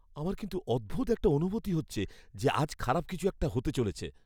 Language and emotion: Bengali, fearful